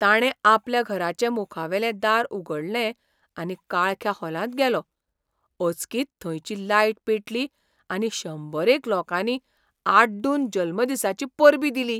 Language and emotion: Goan Konkani, surprised